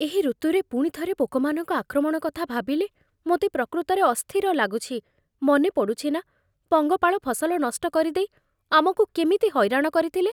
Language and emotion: Odia, fearful